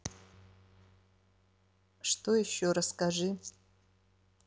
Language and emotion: Russian, neutral